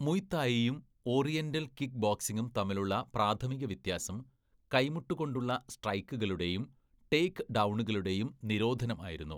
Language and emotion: Malayalam, neutral